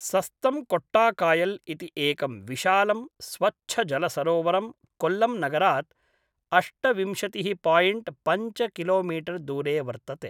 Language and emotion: Sanskrit, neutral